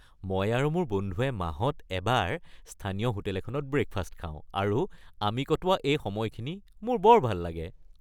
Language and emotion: Assamese, happy